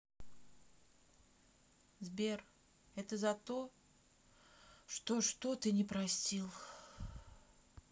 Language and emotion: Russian, sad